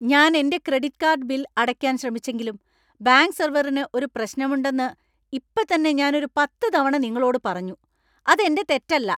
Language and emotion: Malayalam, angry